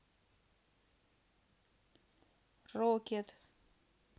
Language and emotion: Russian, neutral